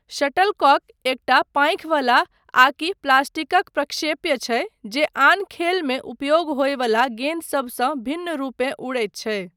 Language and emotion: Maithili, neutral